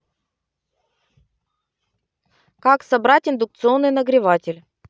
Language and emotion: Russian, positive